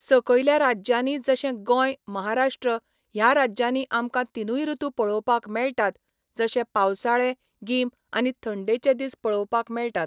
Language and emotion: Goan Konkani, neutral